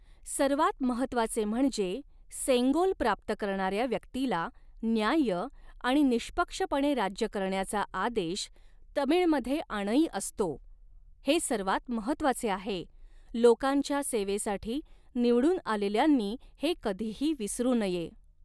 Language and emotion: Marathi, neutral